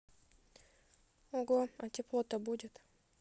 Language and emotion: Russian, neutral